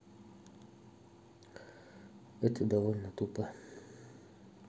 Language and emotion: Russian, neutral